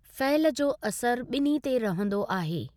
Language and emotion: Sindhi, neutral